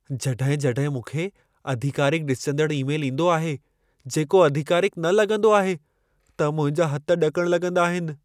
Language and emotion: Sindhi, fearful